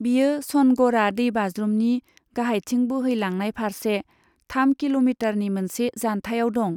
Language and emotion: Bodo, neutral